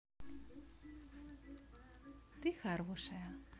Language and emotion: Russian, positive